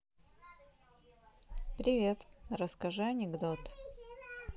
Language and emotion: Russian, neutral